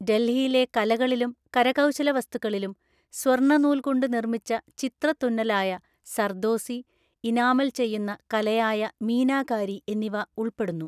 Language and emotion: Malayalam, neutral